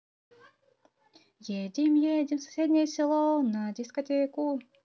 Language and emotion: Russian, positive